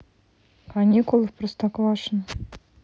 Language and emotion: Russian, neutral